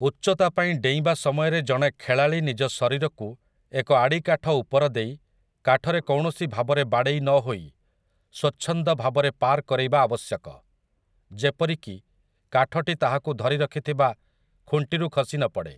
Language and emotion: Odia, neutral